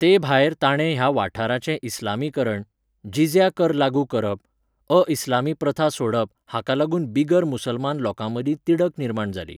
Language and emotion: Goan Konkani, neutral